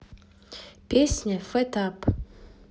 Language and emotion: Russian, neutral